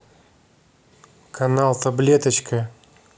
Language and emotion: Russian, neutral